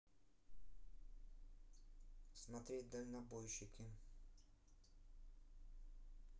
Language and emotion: Russian, neutral